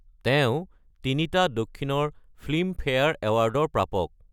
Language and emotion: Assamese, neutral